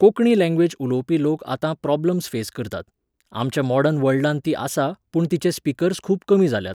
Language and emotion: Goan Konkani, neutral